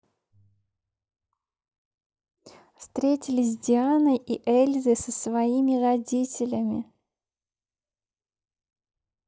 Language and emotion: Russian, neutral